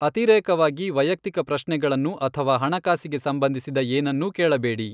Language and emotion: Kannada, neutral